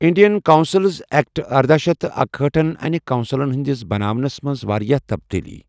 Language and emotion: Kashmiri, neutral